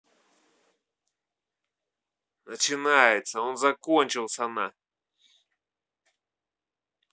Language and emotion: Russian, angry